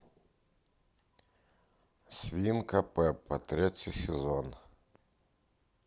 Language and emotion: Russian, neutral